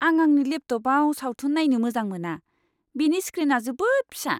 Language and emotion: Bodo, disgusted